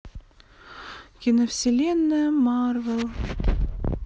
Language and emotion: Russian, sad